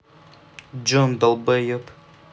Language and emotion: Russian, angry